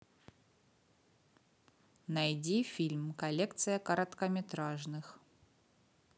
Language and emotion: Russian, neutral